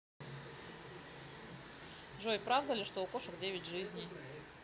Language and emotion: Russian, neutral